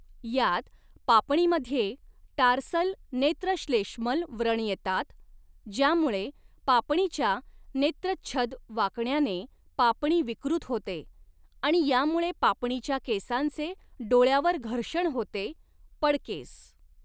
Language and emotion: Marathi, neutral